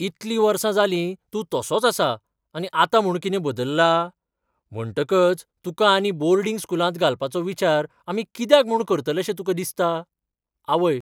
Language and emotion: Goan Konkani, surprised